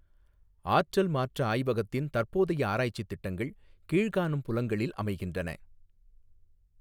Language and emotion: Tamil, neutral